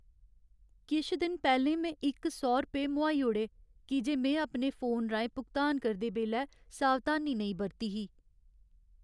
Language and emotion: Dogri, sad